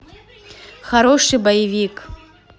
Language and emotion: Russian, neutral